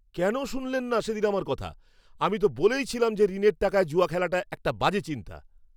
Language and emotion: Bengali, angry